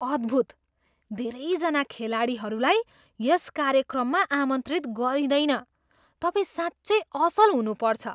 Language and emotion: Nepali, surprised